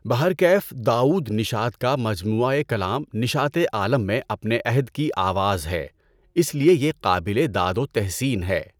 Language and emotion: Urdu, neutral